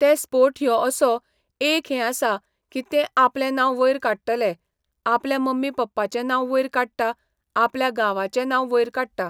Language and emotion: Goan Konkani, neutral